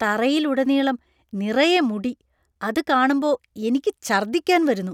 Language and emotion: Malayalam, disgusted